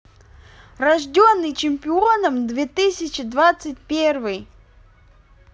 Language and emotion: Russian, positive